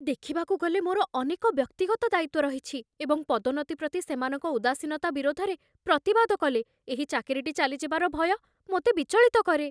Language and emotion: Odia, fearful